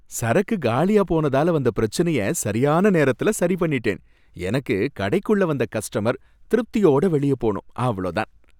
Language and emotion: Tamil, happy